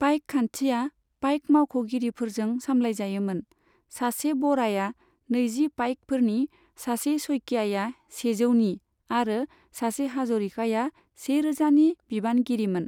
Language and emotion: Bodo, neutral